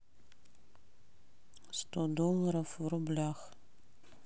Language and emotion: Russian, neutral